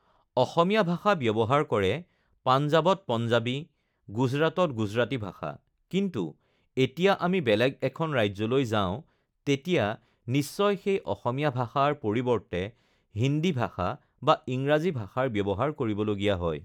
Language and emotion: Assamese, neutral